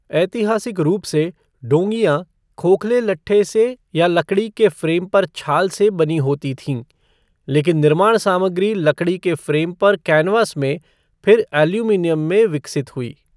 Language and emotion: Hindi, neutral